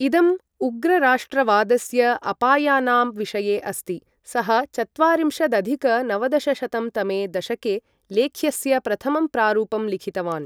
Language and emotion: Sanskrit, neutral